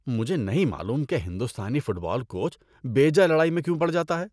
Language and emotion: Urdu, disgusted